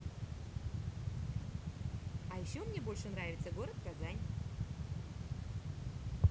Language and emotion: Russian, positive